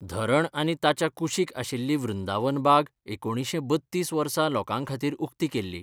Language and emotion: Goan Konkani, neutral